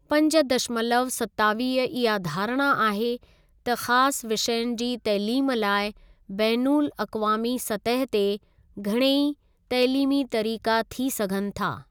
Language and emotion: Sindhi, neutral